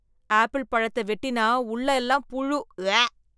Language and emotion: Tamil, disgusted